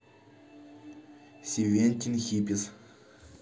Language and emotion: Russian, neutral